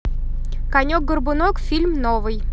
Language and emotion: Russian, positive